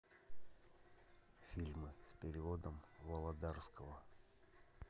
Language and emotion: Russian, neutral